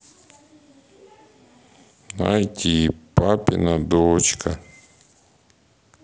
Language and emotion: Russian, sad